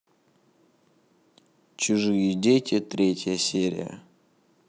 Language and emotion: Russian, neutral